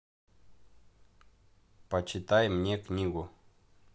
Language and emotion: Russian, neutral